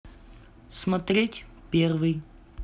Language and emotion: Russian, neutral